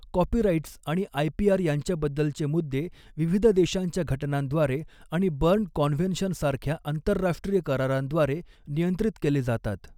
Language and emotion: Marathi, neutral